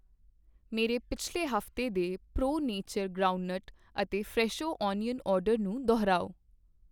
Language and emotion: Punjabi, neutral